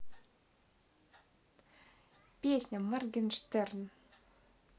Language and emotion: Russian, neutral